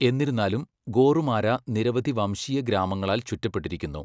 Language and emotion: Malayalam, neutral